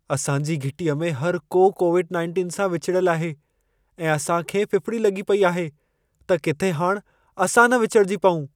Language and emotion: Sindhi, fearful